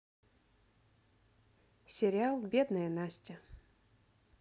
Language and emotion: Russian, neutral